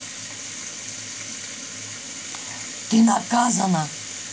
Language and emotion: Russian, angry